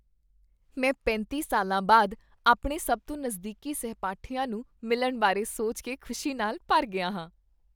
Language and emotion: Punjabi, happy